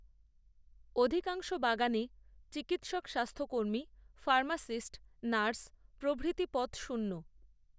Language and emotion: Bengali, neutral